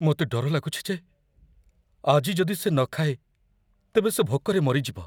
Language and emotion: Odia, fearful